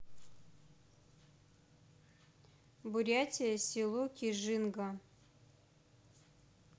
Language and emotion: Russian, neutral